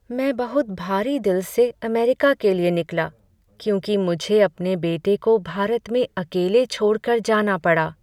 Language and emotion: Hindi, sad